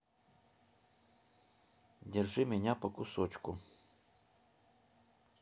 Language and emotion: Russian, neutral